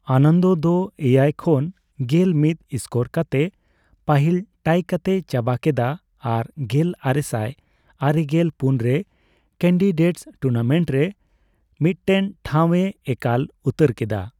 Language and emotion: Santali, neutral